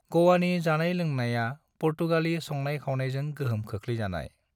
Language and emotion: Bodo, neutral